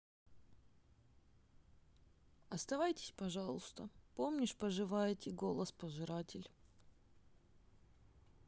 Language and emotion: Russian, sad